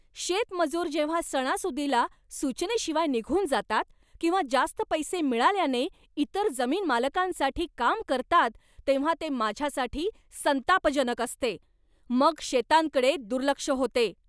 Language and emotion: Marathi, angry